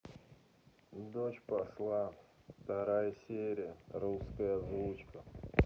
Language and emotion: Russian, sad